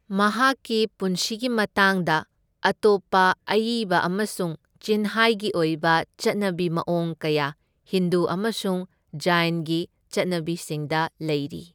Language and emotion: Manipuri, neutral